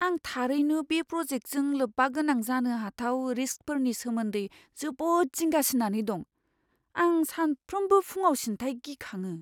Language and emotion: Bodo, fearful